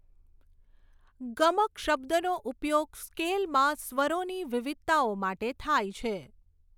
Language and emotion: Gujarati, neutral